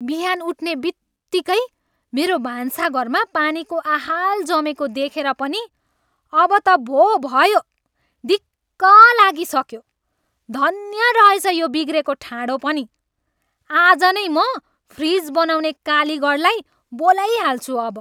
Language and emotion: Nepali, angry